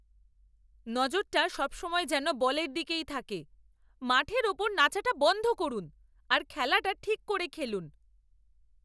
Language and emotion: Bengali, angry